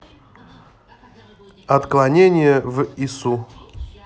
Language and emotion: Russian, neutral